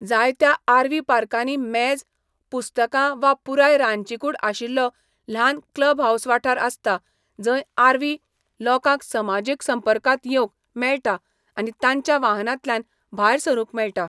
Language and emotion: Goan Konkani, neutral